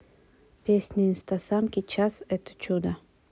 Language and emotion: Russian, neutral